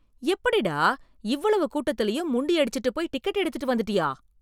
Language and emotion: Tamil, surprised